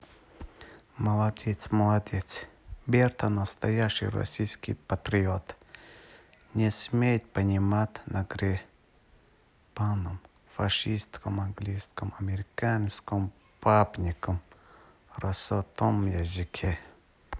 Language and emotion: Russian, neutral